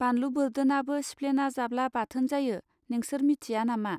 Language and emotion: Bodo, neutral